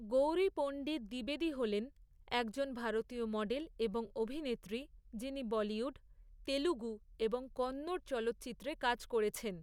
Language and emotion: Bengali, neutral